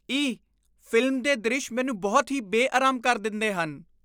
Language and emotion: Punjabi, disgusted